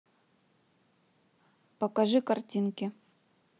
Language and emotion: Russian, neutral